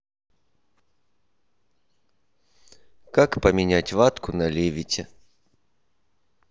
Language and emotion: Russian, neutral